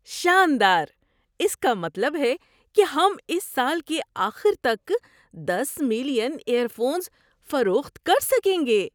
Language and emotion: Urdu, surprised